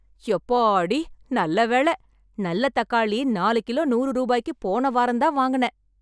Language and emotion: Tamil, happy